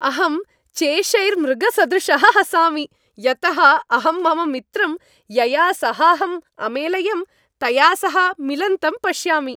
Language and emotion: Sanskrit, happy